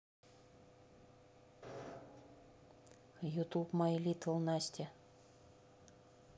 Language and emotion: Russian, neutral